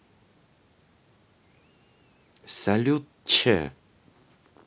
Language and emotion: Russian, positive